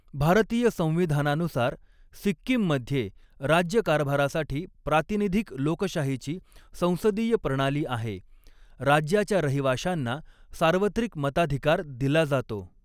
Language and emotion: Marathi, neutral